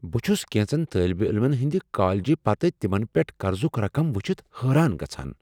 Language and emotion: Kashmiri, surprised